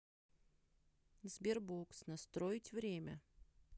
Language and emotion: Russian, neutral